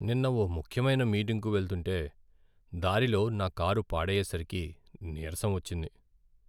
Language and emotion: Telugu, sad